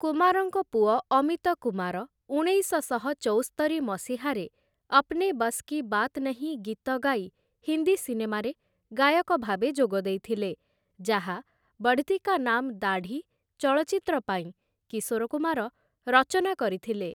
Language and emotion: Odia, neutral